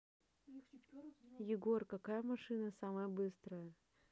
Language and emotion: Russian, neutral